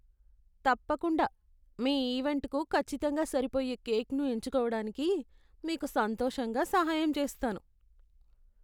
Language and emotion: Telugu, disgusted